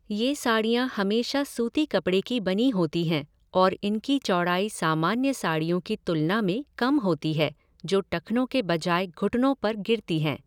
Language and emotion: Hindi, neutral